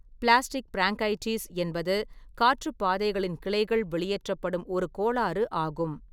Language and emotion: Tamil, neutral